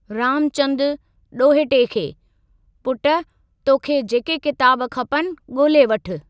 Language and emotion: Sindhi, neutral